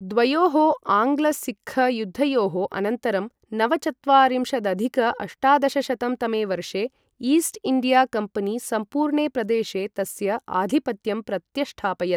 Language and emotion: Sanskrit, neutral